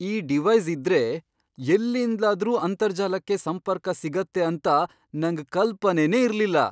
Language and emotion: Kannada, surprised